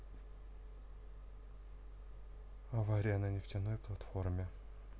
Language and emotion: Russian, neutral